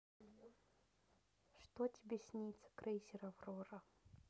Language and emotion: Russian, sad